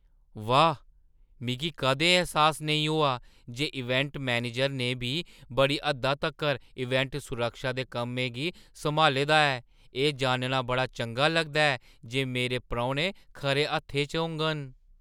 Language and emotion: Dogri, surprised